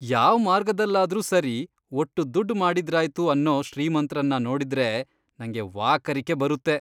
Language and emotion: Kannada, disgusted